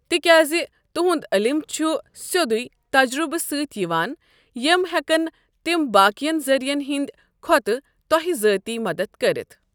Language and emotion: Kashmiri, neutral